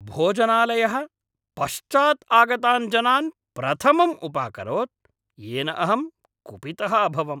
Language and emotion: Sanskrit, angry